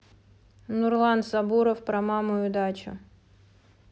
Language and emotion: Russian, neutral